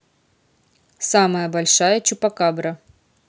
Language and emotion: Russian, neutral